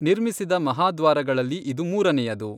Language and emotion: Kannada, neutral